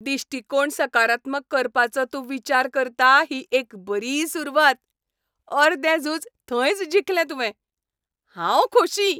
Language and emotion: Goan Konkani, happy